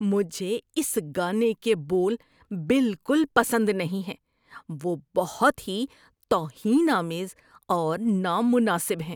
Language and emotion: Urdu, disgusted